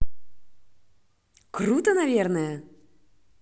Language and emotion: Russian, positive